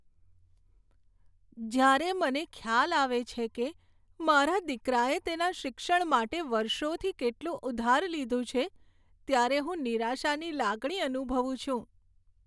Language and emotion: Gujarati, sad